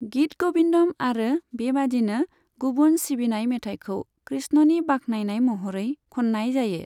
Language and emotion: Bodo, neutral